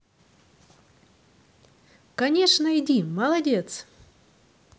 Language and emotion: Russian, positive